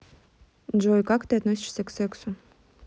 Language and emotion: Russian, neutral